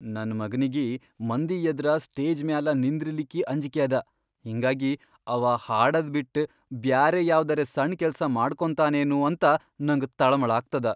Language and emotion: Kannada, fearful